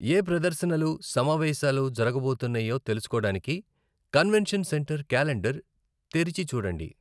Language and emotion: Telugu, neutral